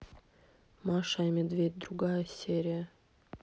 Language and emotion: Russian, neutral